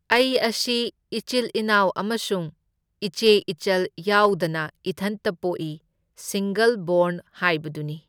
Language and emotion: Manipuri, neutral